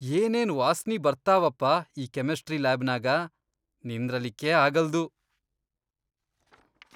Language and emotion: Kannada, disgusted